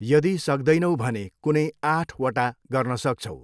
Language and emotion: Nepali, neutral